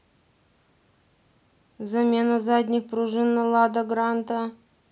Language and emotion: Russian, neutral